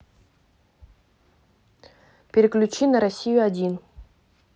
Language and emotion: Russian, neutral